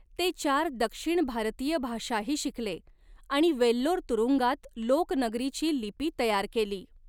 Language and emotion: Marathi, neutral